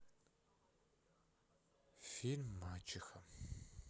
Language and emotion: Russian, sad